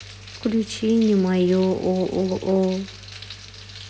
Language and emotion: Russian, sad